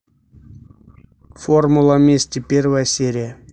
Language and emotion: Russian, neutral